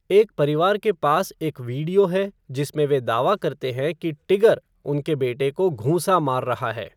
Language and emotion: Hindi, neutral